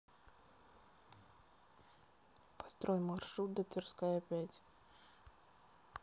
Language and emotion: Russian, neutral